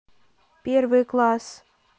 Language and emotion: Russian, neutral